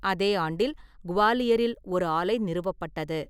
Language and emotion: Tamil, neutral